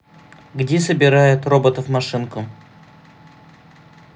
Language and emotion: Russian, neutral